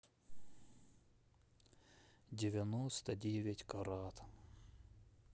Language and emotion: Russian, sad